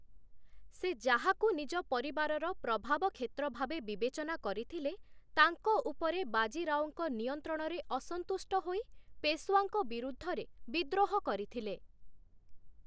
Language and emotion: Odia, neutral